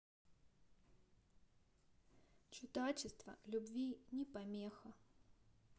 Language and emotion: Russian, neutral